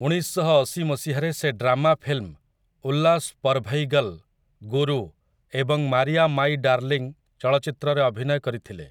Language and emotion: Odia, neutral